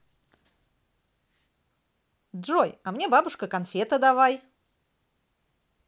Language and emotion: Russian, positive